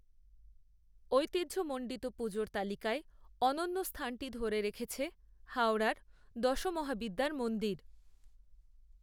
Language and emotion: Bengali, neutral